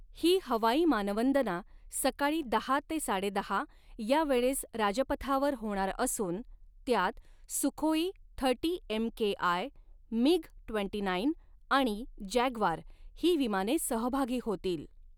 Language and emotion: Marathi, neutral